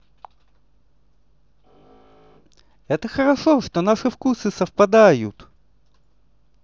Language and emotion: Russian, positive